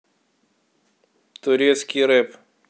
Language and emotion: Russian, neutral